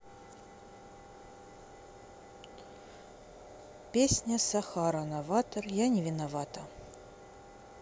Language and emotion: Russian, neutral